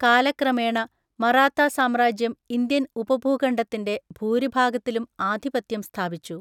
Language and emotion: Malayalam, neutral